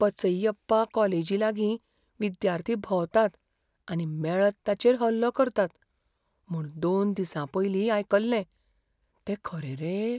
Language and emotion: Goan Konkani, fearful